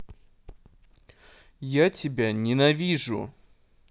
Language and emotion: Russian, angry